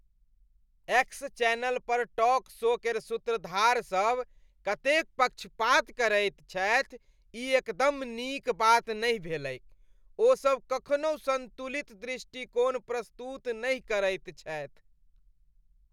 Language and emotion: Maithili, disgusted